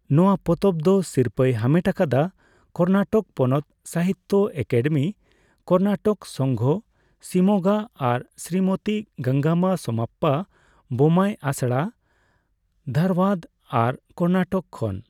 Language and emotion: Santali, neutral